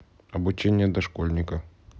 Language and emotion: Russian, neutral